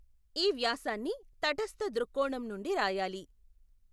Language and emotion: Telugu, neutral